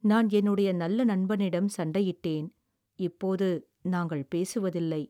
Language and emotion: Tamil, sad